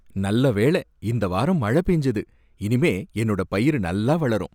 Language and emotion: Tamil, happy